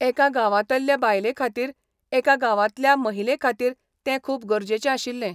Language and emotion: Goan Konkani, neutral